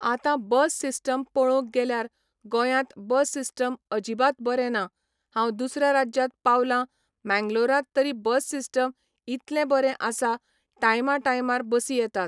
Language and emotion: Goan Konkani, neutral